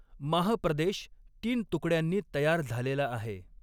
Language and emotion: Marathi, neutral